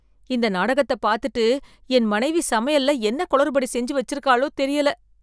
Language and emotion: Tamil, fearful